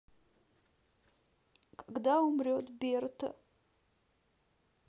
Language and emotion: Russian, sad